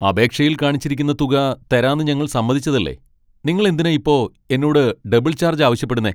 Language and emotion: Malayalam, angry